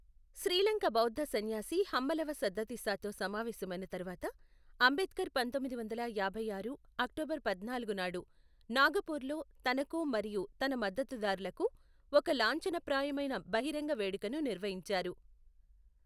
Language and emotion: Telugu, neutral